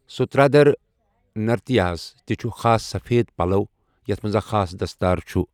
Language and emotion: Kashmiri, neutral